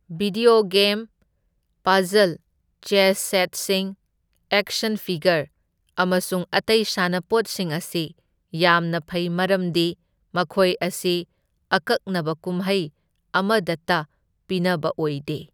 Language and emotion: Manipuri, neutral